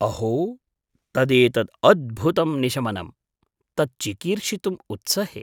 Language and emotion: Sanskrit, surprised